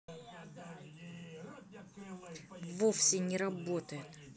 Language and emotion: Russian, angry